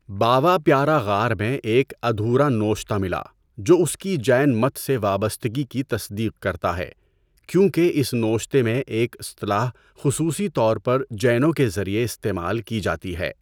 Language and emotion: Urdu, neutral